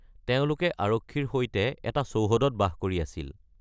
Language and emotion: Assamese, neutral